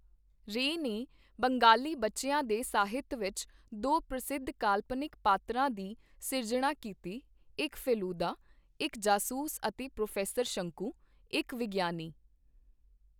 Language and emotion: Punjabi, neutral